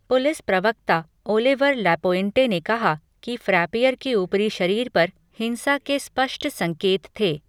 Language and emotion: Hindi, neutral